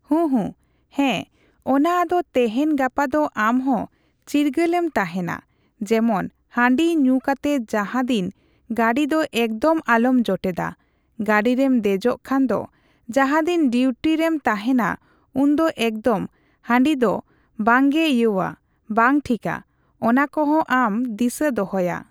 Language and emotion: Santali, neutral